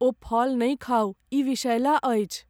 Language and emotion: Maithili, fearful